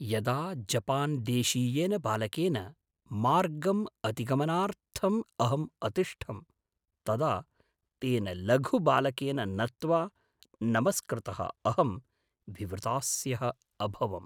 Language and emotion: Sanskrit, surprised